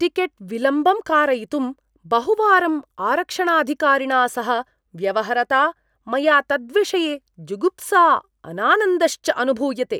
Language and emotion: Sanskrit, disgusted